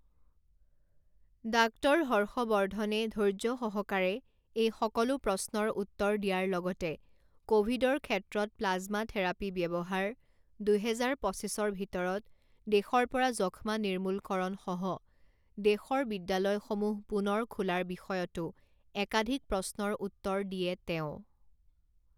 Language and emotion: Assamese, neutral